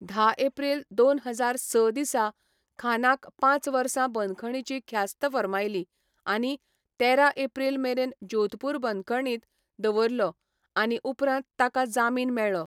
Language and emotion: Goan Konkani, neutral